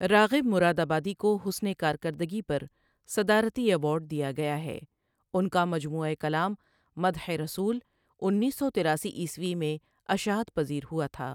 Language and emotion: Urdu, neutral